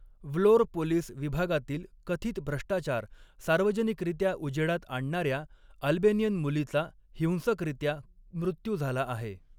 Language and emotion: Marathi, neutral